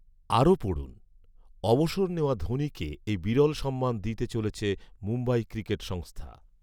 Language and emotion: Bengali, neutral